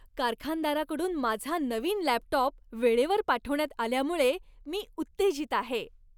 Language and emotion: Marathi, happy